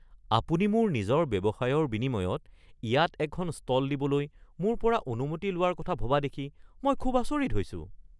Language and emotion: Assamese, surprised